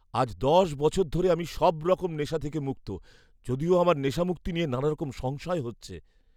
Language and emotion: Bengali, fearful